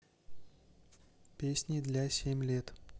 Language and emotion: Russian, neutral